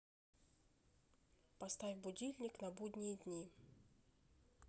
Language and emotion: Russian, neutral